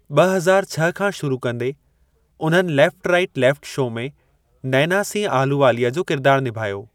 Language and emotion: Sindhi, neutral